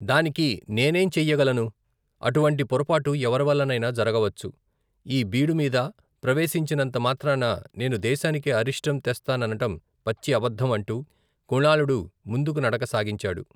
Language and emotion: Telugu, neutral